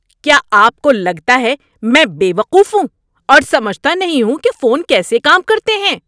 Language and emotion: Urdu, angry